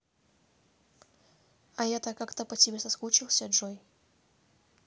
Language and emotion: Russian, neutral